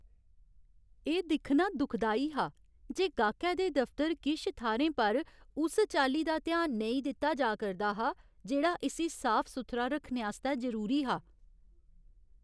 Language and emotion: Dogri, sad